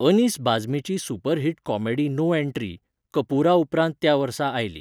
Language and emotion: Goan Konkani, neutral